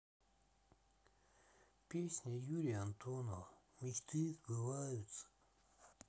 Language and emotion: Russian, sad